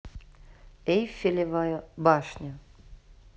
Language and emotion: Russian, neutral